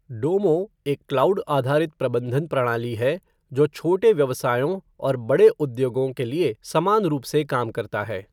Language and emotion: Hindi, neutral